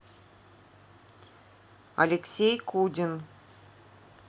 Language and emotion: Russian, neutral